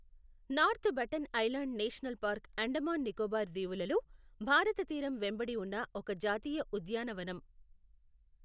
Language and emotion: Telugu, neutral